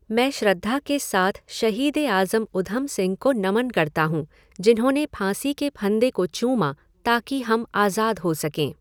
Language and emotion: Hindi, neutral